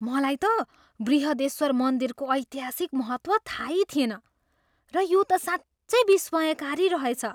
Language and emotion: Nepali, surprised